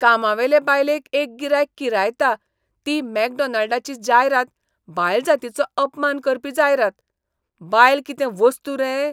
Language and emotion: Goan Konkani, disgusted